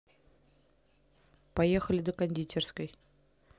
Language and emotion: Russian, neutral